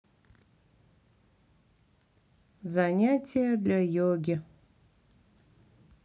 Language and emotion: Russian, neutral